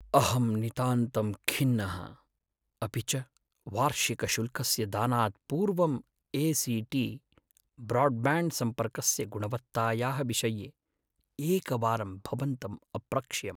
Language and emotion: Sanskrit, sad